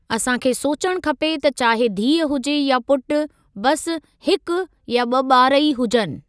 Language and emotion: Sindhi, neutral